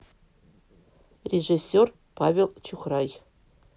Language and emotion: Russian, neutral